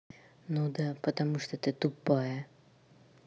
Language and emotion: Russian, angry